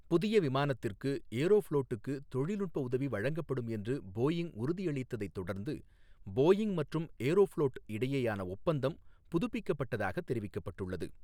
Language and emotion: Tamil, neutral